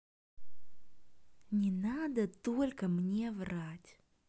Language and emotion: Russian, neutral